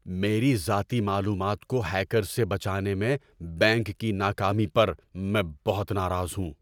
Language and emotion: Urdu, angry